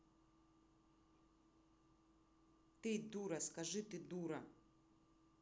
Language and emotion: Russian, angry